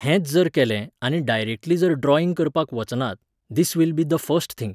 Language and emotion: Goan Konkani, neutral